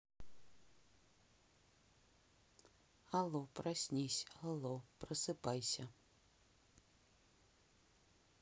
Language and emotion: Russian, neutral